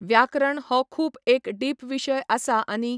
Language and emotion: Goan Konkani, neutral